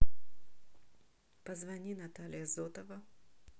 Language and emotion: Russian, neutral